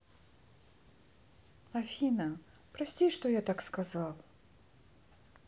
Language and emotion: Russian, sad